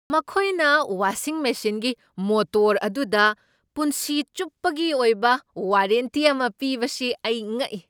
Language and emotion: Manipuri, surprised